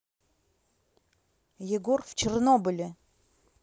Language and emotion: Russian, neutral